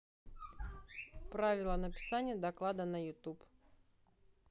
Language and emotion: Russian, neutral